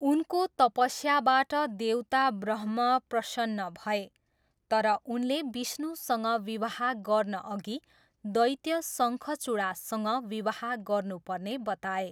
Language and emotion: Nepali, neutral